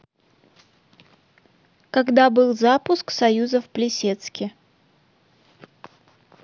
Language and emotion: Russian, neutral